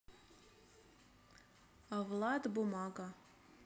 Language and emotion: Russian, neutral